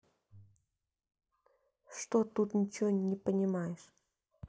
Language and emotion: Russian, neutral